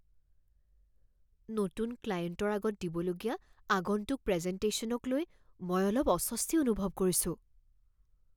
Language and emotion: Assamese, fearful